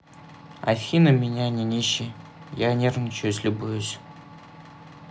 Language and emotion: Russian, neutral